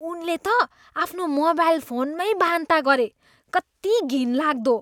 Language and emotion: Nepali, disgusted